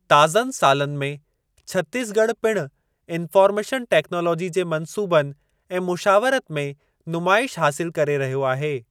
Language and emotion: Sindhi, neutral